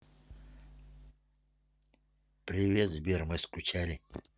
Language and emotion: Russian, neutral